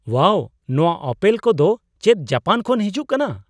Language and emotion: Santali, surprised